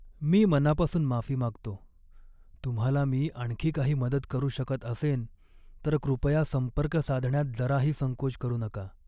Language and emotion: Marathi, sad